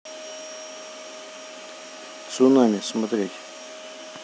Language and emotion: Russian, neutral